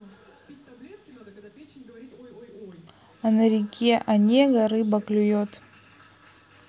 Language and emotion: Russian, neutral